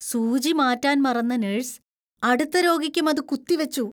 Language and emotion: Malayalam, disgusted